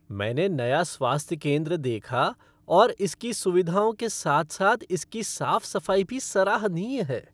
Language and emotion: Hindi, happy